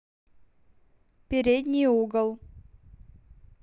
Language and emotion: Russian, neutral